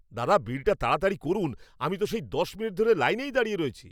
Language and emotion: Bengali, angry